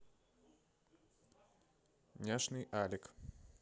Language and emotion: Russian, neutral